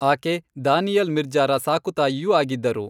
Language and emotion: Kannada, neutral